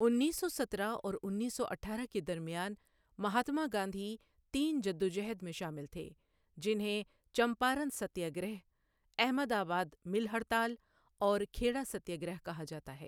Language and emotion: Urdu, neutral